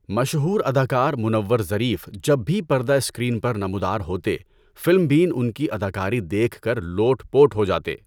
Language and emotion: Urdu, neutral